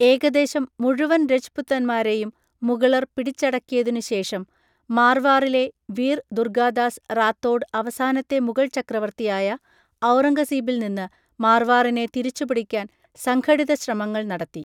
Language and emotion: Malayalam, neutral